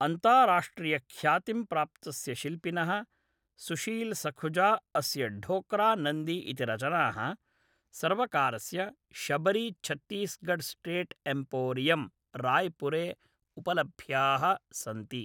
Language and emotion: Sanskrit, neutral